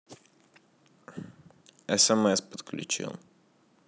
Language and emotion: Russian, neutral